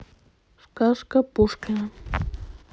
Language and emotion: Russian, neutral